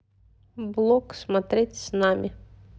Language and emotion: Russian, neutral